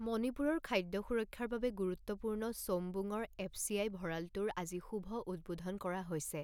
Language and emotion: Assamese, neutral